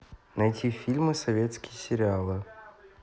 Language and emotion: Russian, neutral